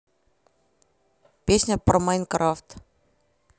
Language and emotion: Russian, neutral